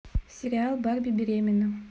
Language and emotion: Russian, neutral